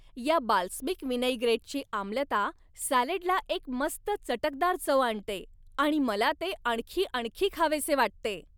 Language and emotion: Marathi, happy